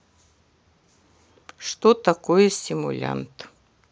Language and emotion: Russian, neutral